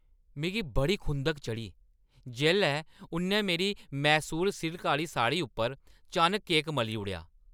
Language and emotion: Dogri, angry